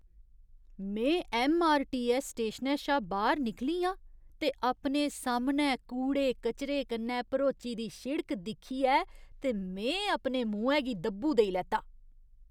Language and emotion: Dogri, disgusted